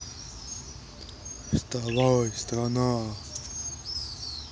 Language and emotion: Russian, neutral